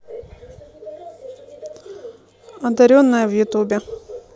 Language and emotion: Russian, neutral